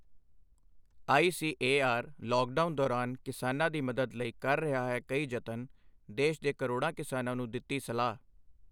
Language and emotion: Punjabi, neutral